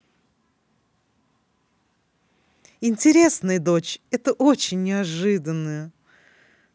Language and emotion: Russian, positive